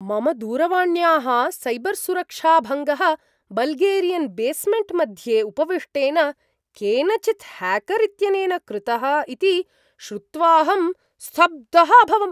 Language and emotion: Sanskrit, surprised